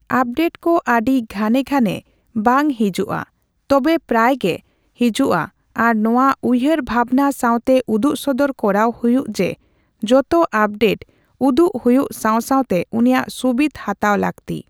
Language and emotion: Santali, neutral